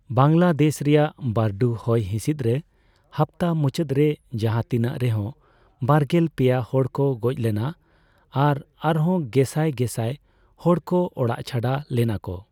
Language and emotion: Santali, neutral